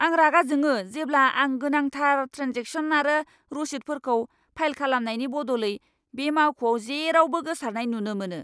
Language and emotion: Bodo, angry